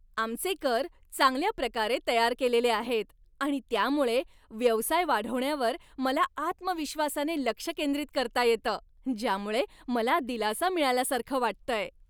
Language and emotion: Marathi, happy